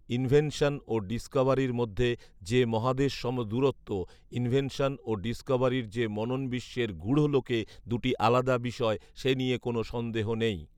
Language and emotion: Bengali, neutral